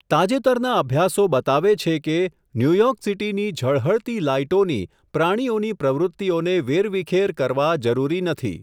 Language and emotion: Gujarati, neutral